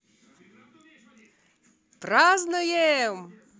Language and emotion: Russian, positive